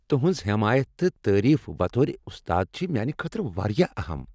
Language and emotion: Kashmiri, happy